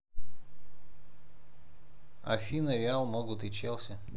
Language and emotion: Russian, neutral